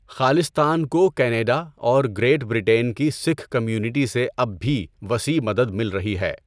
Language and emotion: Urdu, neutral